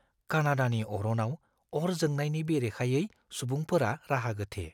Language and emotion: Bodo, fearful